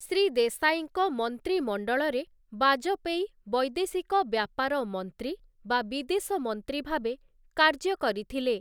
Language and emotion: Odia, neutral